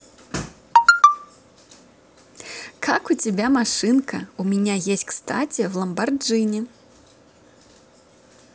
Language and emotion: Russian, positive